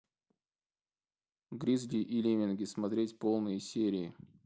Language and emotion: Russian, neutral